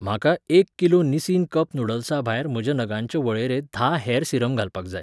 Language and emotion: Goan Konkani, neutral